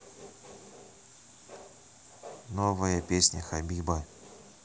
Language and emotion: Russian, neutral